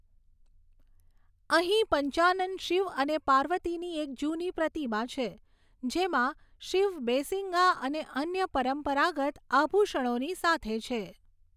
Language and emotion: Gujarati, neutral